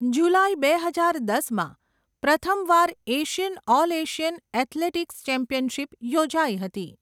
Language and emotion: Gujarati, neutral